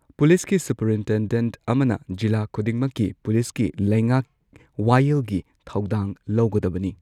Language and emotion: Manipuri, neutral